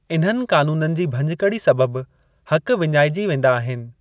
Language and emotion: Sindhi, neutral